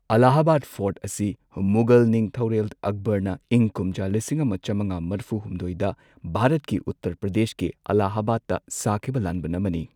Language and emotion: Manipuri, neutral